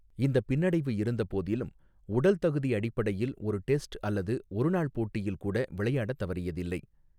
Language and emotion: Tamil, neutral